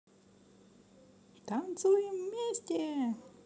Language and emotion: Russian, positive